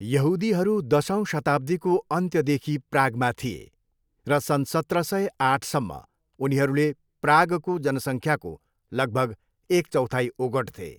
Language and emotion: Nepali, neutral